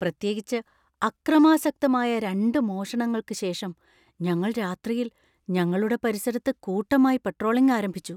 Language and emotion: Malayalam, fearful